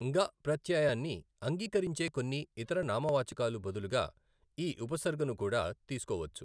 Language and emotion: Telugu, neutral